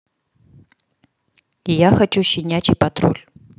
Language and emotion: Russian, neutral